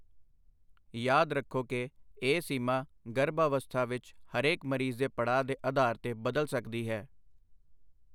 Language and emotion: Punjabi, neutral